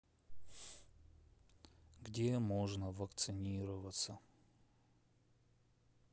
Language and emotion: Russian, sad